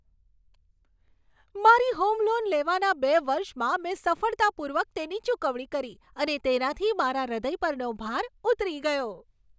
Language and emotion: Gujarati, happy